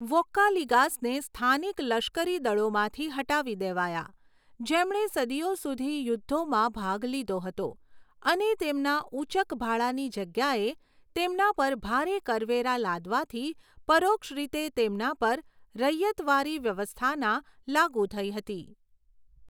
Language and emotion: Gujarati, neutral